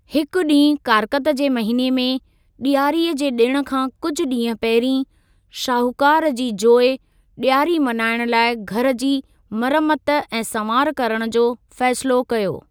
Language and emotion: Sindhi, neutral